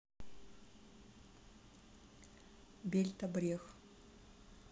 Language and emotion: Russian, neutral